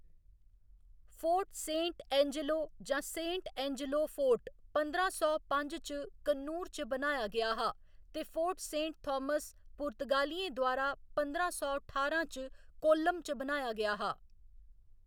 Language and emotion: Dogri, neutral